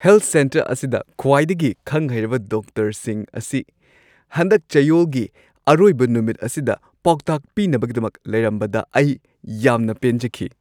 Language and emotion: Manipuri, happy